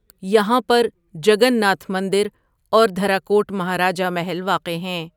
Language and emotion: Urdu, neutral